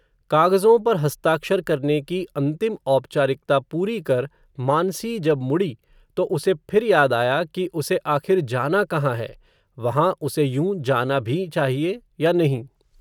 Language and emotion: Hindi, neutral